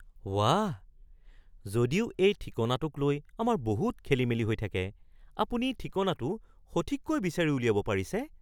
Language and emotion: Assamese, surprised